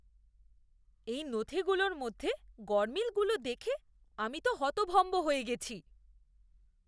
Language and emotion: Bengali, disgusted